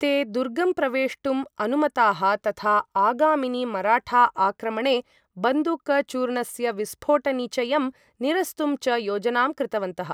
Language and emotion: Sanskrit, neutral